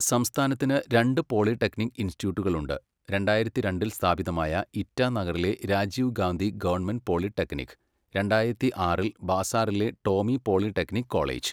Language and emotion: Malayalam, neutral